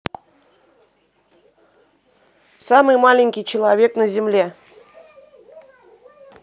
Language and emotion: Russian, neutral